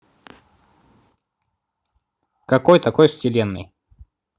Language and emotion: Russian, neutral